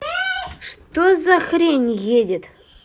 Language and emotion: Russian, angry